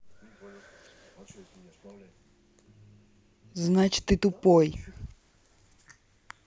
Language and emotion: Russian, angry